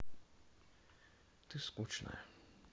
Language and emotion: Russian, sad